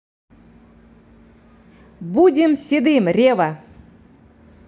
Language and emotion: Russian, positive